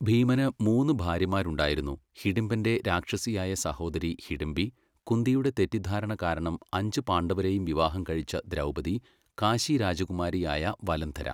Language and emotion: Malayalam, neutral